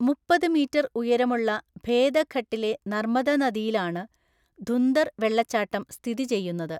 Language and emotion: Malayalam, neutral